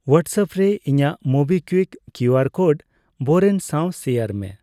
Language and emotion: Santali, neutral